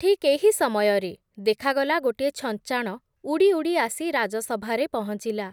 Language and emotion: Odia, neutral